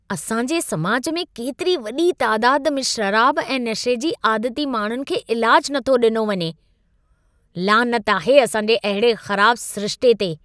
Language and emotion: Sindhi, disgusted